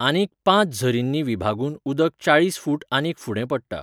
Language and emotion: Goan Konkani, neutral